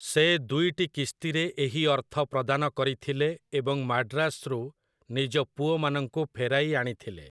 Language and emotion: Odia, neutral